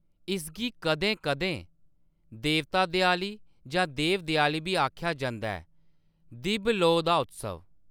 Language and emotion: Dogri, neutral